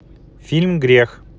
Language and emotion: Russian, neutral